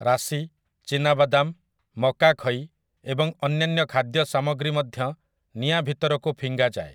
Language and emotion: Odia, neutral